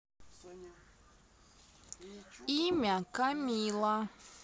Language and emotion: Russian, neutral